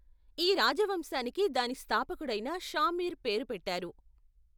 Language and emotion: Telugu, neutral